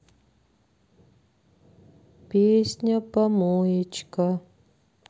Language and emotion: Russian, sad